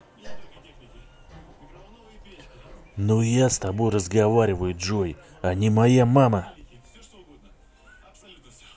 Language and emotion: Russian, angry